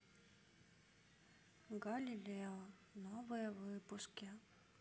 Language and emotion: Russian, sad